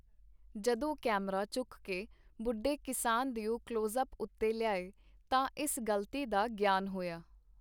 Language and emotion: Punjabi, neutral